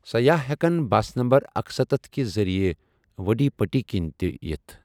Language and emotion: Kashmiri, neutral